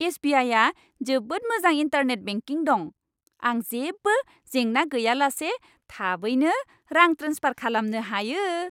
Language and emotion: Bodo, happy